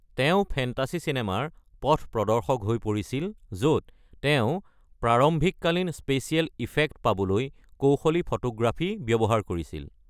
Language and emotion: Assamese, neutral